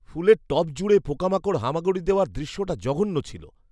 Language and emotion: Bengali, disgusted